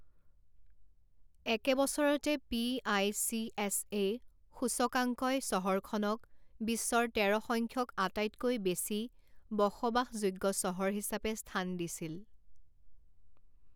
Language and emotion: Assamese, neutral